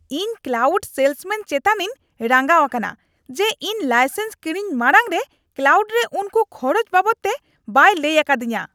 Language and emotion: Santali, angry